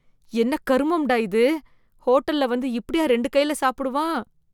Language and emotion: Tamil, disgusted